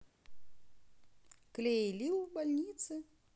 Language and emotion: Russian, positive